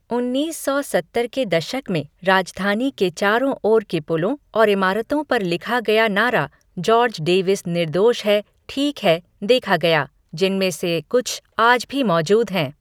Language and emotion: Hindi, neutral